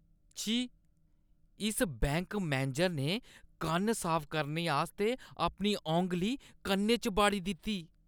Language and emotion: Dogri, disgusted